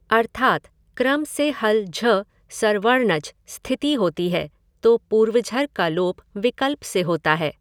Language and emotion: Hindi, neutral